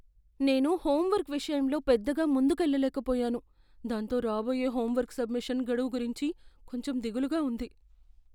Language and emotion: Telugu, fearful